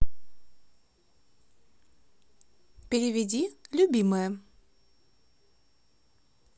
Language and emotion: Russian, positive